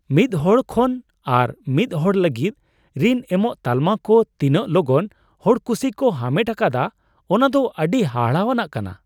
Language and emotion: Santali, surprised